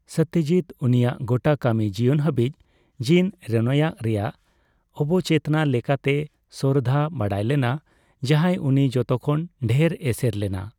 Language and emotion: Santali, neutral